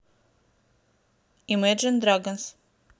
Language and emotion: Russian, neutral